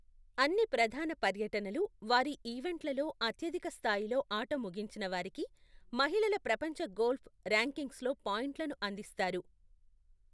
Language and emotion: Telugu, neutral